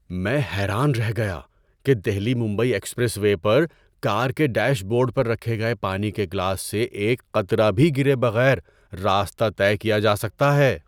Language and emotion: Urdu, surprised